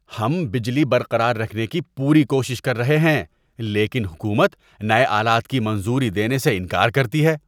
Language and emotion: Urdu, disgusted